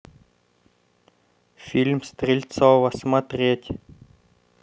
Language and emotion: Russian, neutral